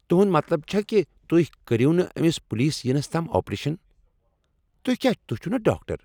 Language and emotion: Kashmiri, angry